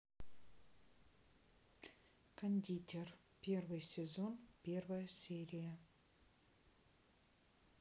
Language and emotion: Russian, neutral